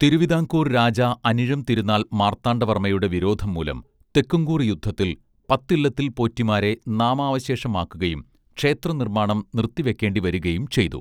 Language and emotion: Malayalam, neutral